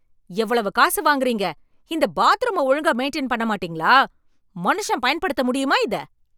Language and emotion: Tamil, angry